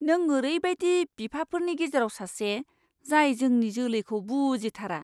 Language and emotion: Bodo, disgusted